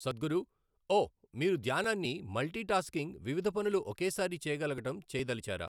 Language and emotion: Telugu, neutral